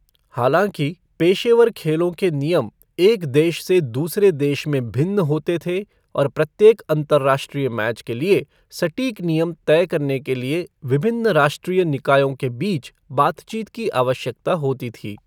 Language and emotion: Hindi, neutral